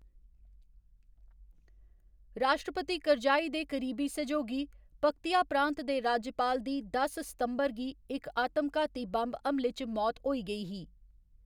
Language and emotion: Dogri, neutral